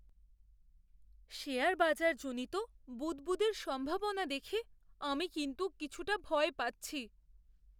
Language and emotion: Bengali, fearful